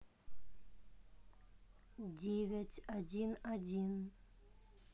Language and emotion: Russian, neutral